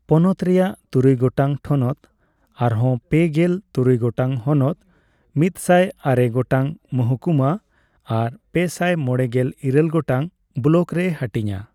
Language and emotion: Santali, neutral